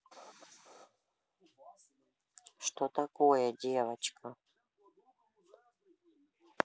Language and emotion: Russian, neutral